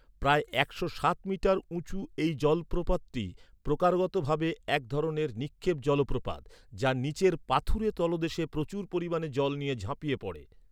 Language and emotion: Bengali, neutral